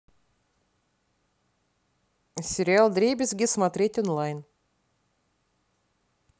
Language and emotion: Russian, neutral